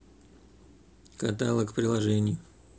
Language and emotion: Russian, neutral